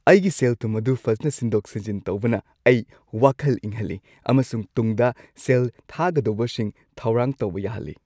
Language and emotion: Manipuri, happy